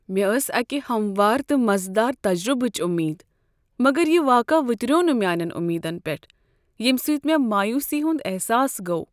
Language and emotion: Kashmiri, sad